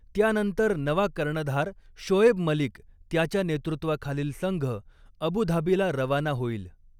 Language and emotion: Marathi, neutral